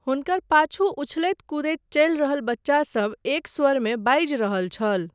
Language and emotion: Maithili, neutral